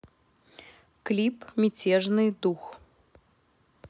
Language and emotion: Russian, neutral